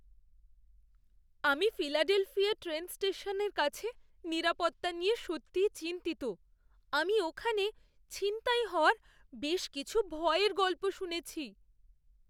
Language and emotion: Bengali, fearful